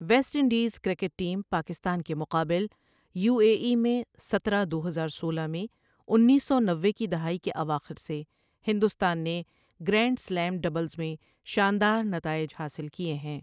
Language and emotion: Urdu, neutral